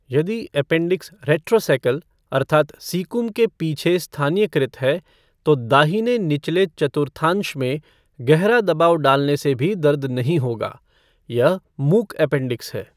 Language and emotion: Hindi, neutral